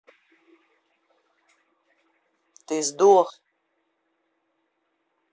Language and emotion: Russian, angry